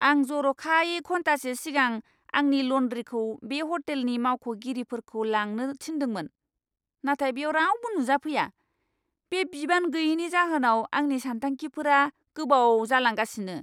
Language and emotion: Bodo, angry